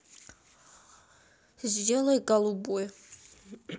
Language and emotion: Russian, neutral